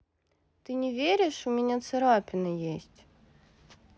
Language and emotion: Russian, neutral